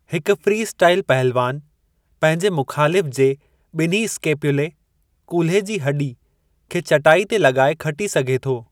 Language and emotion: Sindhi, neutral